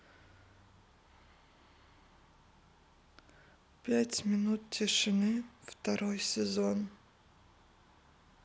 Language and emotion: Russian, sad